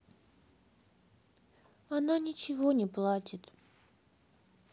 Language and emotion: Russian, sad